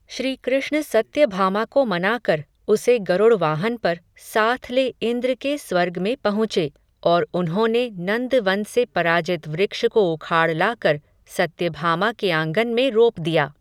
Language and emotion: Hindi, neutral